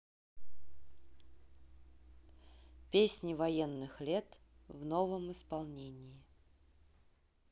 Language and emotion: Russian, neutral